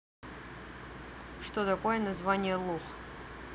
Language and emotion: Russian, neutral